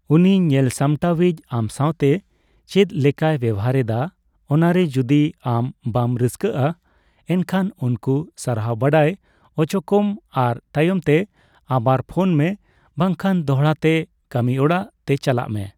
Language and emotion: Santali, neutral